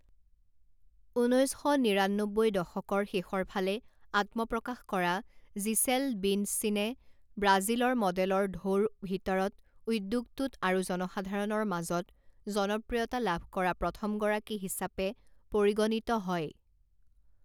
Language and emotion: Assamese, neutral